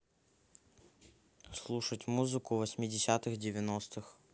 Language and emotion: Russian, neutral